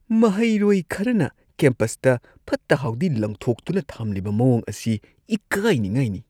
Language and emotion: Manipuri, disgusted